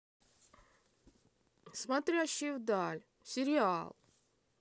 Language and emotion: Russian, neutral